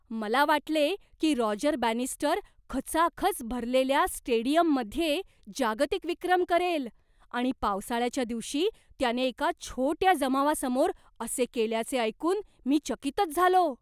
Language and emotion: Marathi, surprised